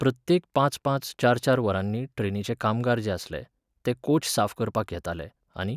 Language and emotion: Goan Konkani, neutral